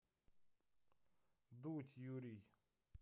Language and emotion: Russian, neutral